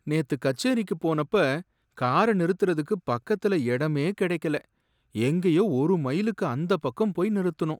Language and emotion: Tamil, sad